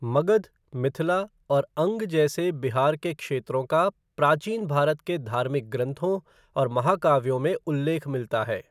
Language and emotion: Hindi, neutral